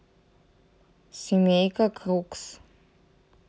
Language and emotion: Russian, neutral